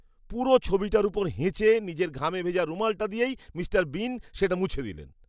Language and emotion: Bengali, disgusted